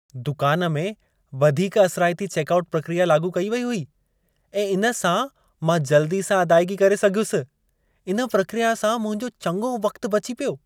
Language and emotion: Sindhi, happy